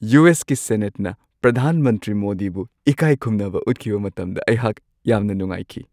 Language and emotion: Manipuri, happy